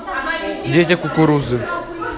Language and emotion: Russian, neutral